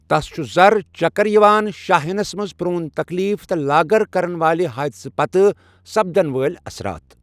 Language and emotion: Kashmiri, neutral